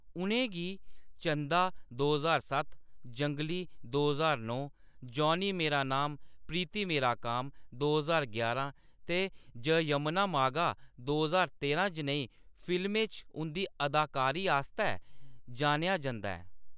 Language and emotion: Dogri, neutral